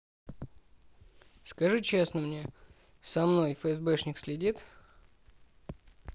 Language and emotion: Russian, neutral